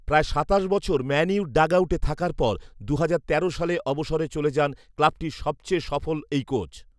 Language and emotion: Bengali, neutral